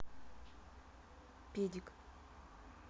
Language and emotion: Russian, neutral